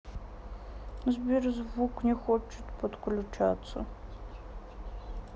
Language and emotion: Russian, sad